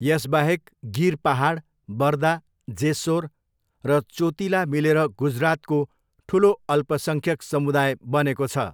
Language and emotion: Nepali, neutral